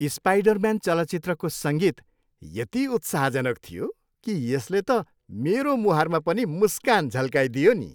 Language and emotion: Nepali, happy